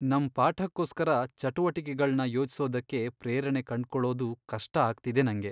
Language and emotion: Kannada, sad